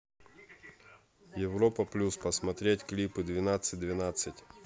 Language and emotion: Russian, neutral